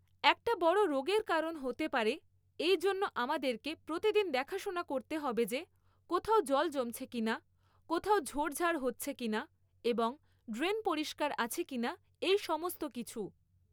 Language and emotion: Bengali, neutral